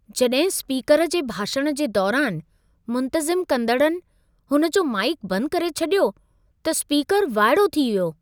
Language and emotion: Sindhi, surprised